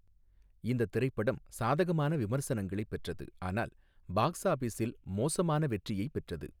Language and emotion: Tamil, neutral